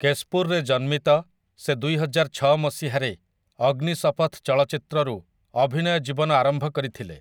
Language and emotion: Odia, neutral